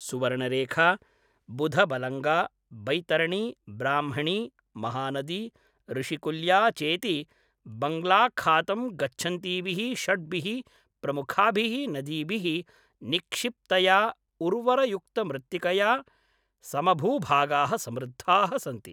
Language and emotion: Sanskrit, neutral